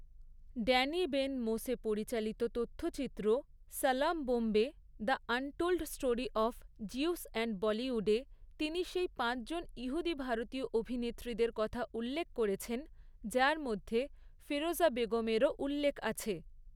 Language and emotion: Bengali, neutral